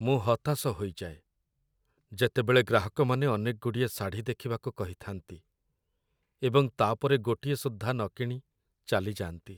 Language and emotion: Odia, sad